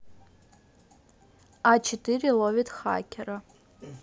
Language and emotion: Russian, neutral